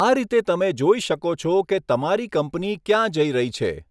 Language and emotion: Gujarati, neutral